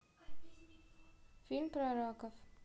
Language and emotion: Russian, neutral